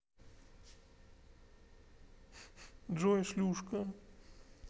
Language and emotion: Russian, neutral